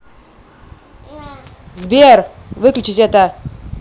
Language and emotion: Russian, angry